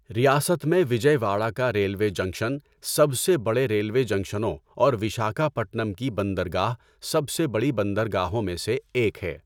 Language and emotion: Urdu, neutral